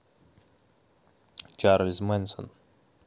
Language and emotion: Russian, neutral